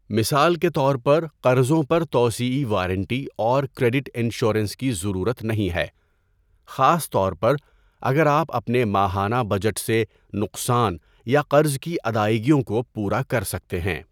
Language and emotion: Urdu, neutral